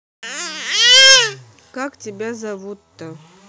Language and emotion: Russian, neutral